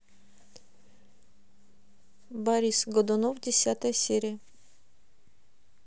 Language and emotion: Russian, neutral